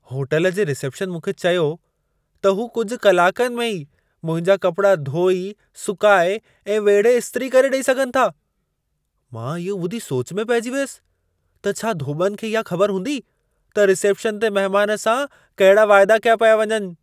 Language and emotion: Sindhi, surprised